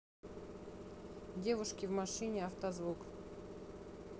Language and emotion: Russian, neutral